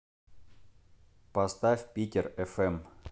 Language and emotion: Russian, neutral